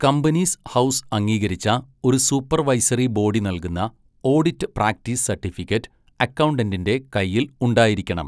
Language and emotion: Malayalam, neutral